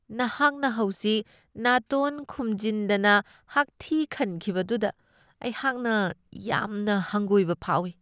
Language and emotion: Manipuri, disgusted